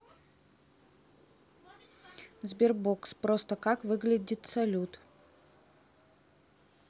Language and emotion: Russian, neutral